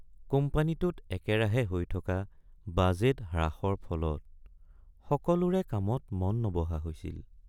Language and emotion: Assamese, sad